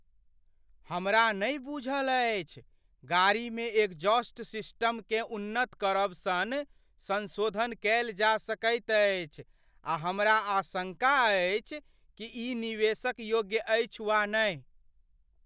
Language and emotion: Maithili, fearful